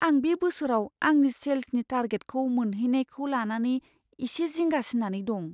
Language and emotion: Bodo, fearful